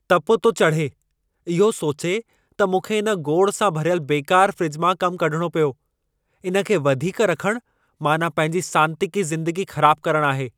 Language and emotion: Sindhi, angry